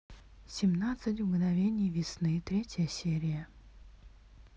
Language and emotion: Russian, neutral